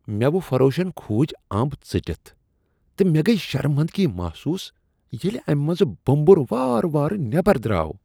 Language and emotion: Kashmiri, disgusted